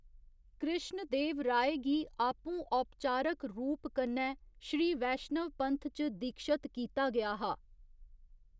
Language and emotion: Dogri, neutral